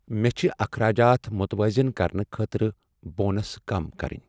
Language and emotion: Kashmiri, sad